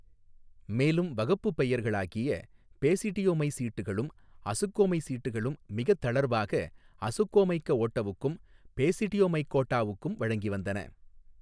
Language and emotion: Tamil, neutral